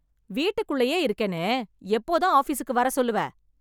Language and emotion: Tamil, angry